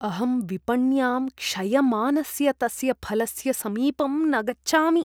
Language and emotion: Sanskrit, disgusted